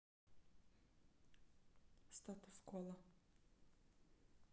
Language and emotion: Russian, neutral